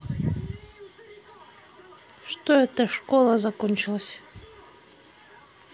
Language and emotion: Russian, neutral